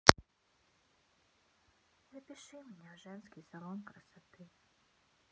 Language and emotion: Russian, sad